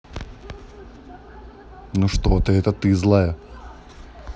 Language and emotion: Russian, neutral